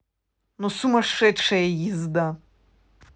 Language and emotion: Russian, angry